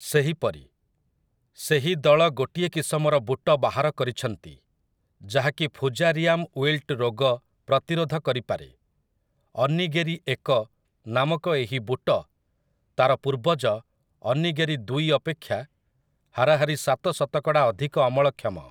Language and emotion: Odia, neutral